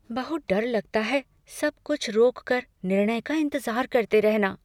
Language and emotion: Hindi, fearful